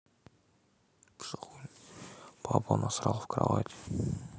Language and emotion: Russian, neutral